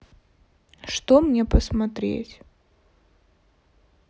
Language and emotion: Russian, neutral